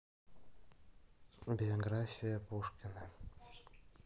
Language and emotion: Russian, sad